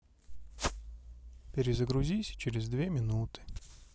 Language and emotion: Russian, neutral